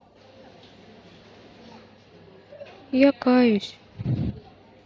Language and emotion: Russian, sad